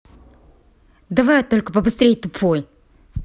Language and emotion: Russian, angry